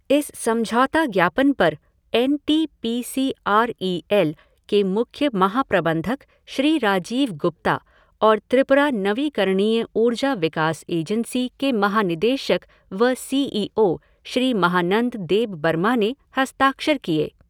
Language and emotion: Hindi, neutral